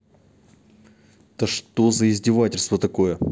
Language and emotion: Russian, angry